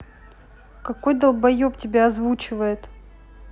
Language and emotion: Russian, angry